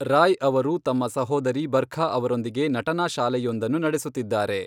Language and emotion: Kannada, neutral